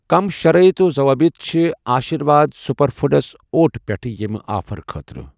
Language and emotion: Kashmiri, neutral